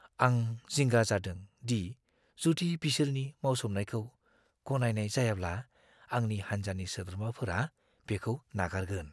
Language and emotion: Bodo, fearful